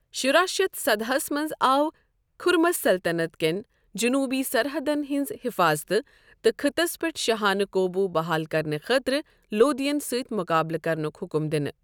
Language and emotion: Kashmiri, neutral